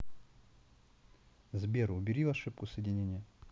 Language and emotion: Russian, neutral